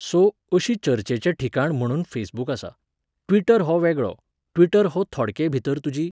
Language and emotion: Goan Konkani, neutral